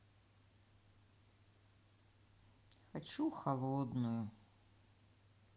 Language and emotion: Russian, sad